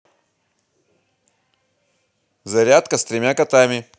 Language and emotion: Russian, positive